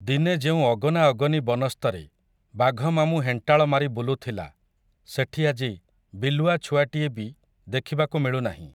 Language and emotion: Odia, neutral